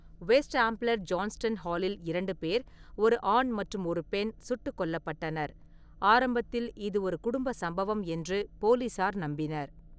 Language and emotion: Tamil, neutral